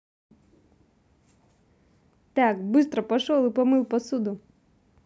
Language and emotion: Russian, neutral